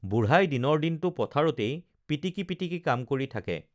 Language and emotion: Assamese, neutral